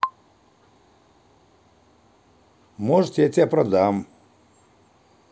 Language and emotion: Russian, neutral